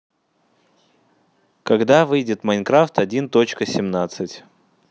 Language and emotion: Russian, neutral